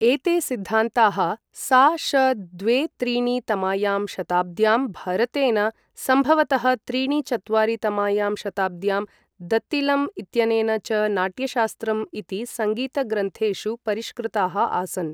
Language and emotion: Sanskrit, neutral